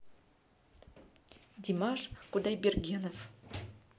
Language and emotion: Russian, neutral